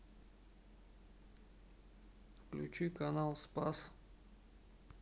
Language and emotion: Russian, sad